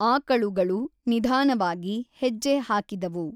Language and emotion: Kannada, neutral